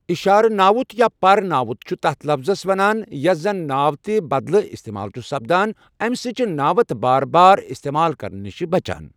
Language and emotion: Kashmiri, neutral